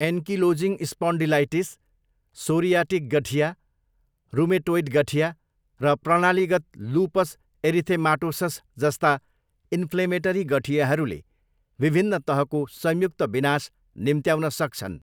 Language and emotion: Nepali, neutral